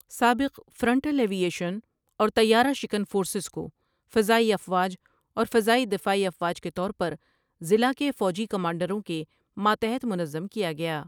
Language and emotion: Urdu, neutral